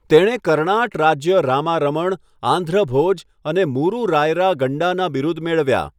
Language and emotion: Gujarati, neutral